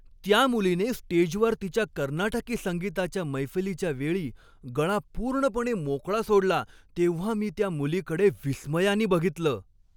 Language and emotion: Marathi, happy